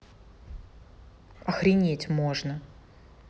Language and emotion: Russian, angry